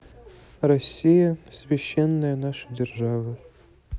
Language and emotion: Russian, sad